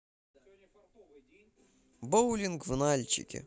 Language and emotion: Russian, positive